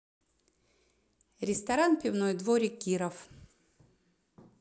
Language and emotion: Russian, neutral